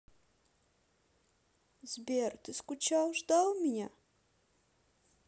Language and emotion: Russian, neutral